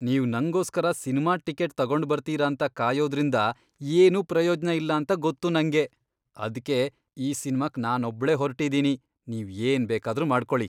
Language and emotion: Kannada, disgusted